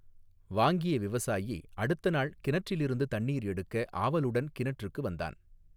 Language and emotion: Tamil, neutral